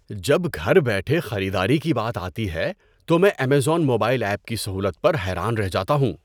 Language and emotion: Urdu, surprised